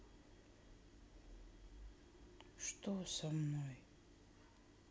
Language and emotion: Russian, sad